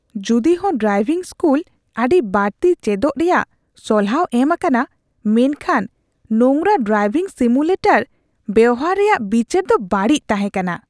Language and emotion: Santali, disgusted